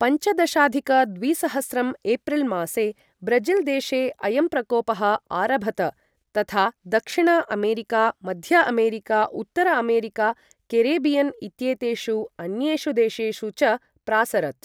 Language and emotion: Sanskrit, neutral